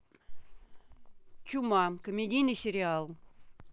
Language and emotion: Russian, neutral